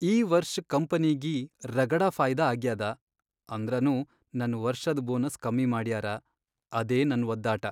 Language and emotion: Kannada, sad